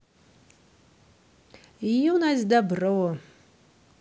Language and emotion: Russian, positive